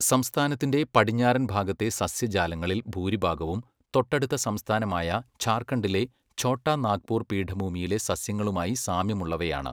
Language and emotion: Malayalam, neutral